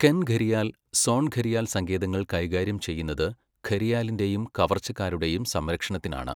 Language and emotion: Malayalam, neutral